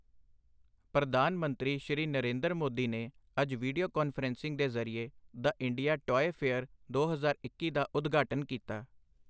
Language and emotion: Punjabi, neutral